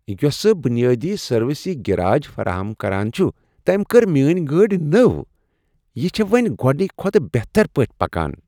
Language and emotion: Kashmiri, happy